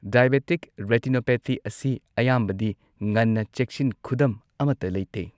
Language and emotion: Manipuri, neutral